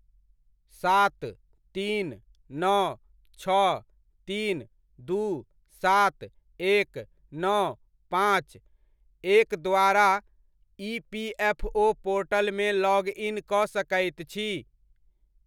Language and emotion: Maithili, neutral